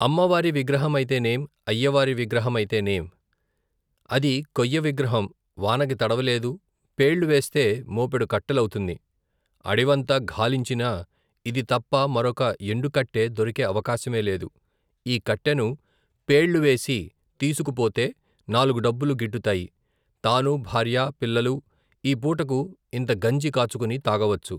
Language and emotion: Telugu, neutral